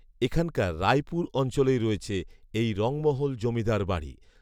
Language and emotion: Bengali, neutral